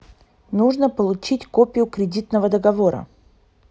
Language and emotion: Russian, neutral